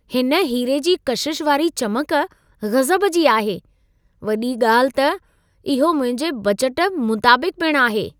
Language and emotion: Sindhi, surprised